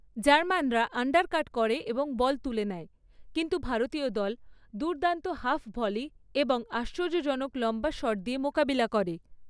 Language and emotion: Bengali, neutral